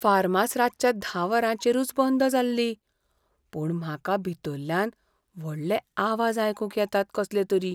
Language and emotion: Goan Konkani, fearful